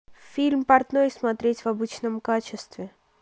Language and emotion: Russian, neutral